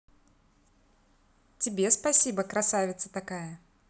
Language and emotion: Russian, positive